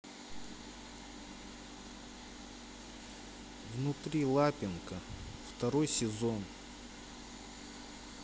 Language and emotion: Russian, sad